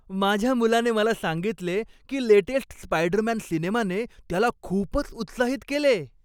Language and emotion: Marathi, happy